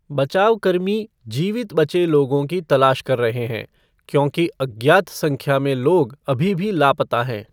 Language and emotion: Hindi, neutral